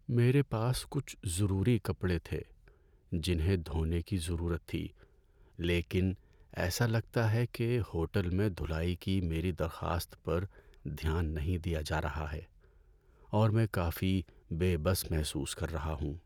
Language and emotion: Urdu, sad